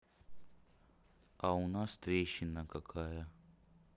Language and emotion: Russian, neutral